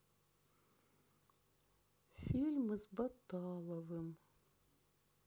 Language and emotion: Russian, sad